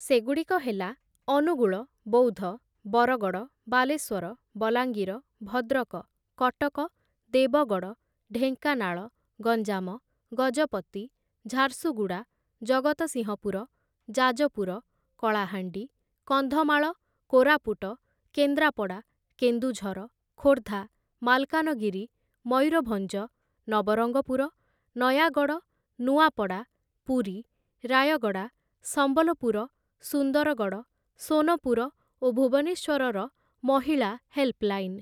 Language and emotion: Odia, neutral